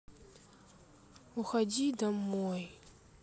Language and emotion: Russian, sad